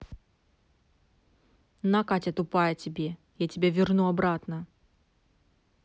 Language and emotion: Russian, angry